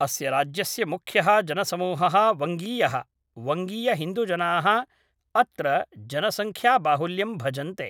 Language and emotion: Sanskrit, neutral